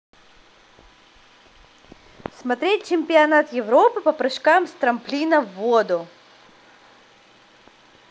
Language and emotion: Russian, positive